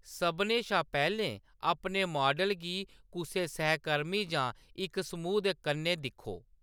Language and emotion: Dogri, neutral